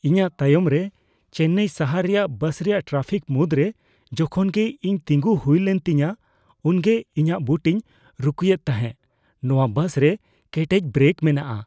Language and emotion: Santali, fearful